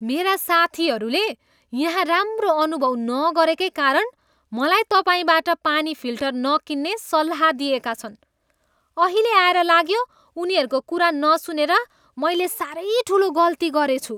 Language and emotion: Nepali, disgusted